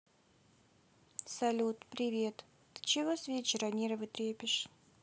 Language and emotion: Russian, sad